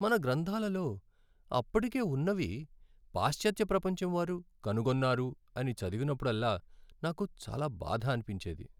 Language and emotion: Telugu, sad